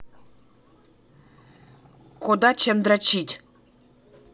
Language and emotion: Russian, neutral